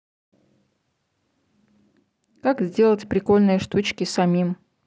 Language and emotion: Russian, neutral